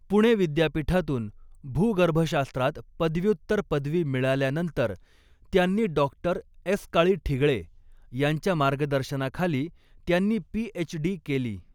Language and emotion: Marathi, neutral